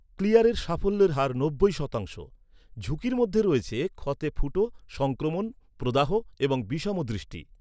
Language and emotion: Bengali, neutral